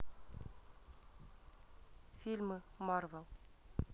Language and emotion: Russian, neutral